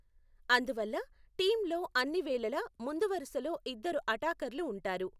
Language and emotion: Telugu, neutral